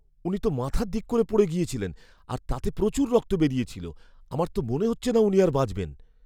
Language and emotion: Bengali, fearful